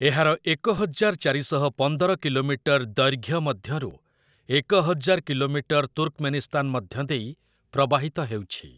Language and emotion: Odia, neutral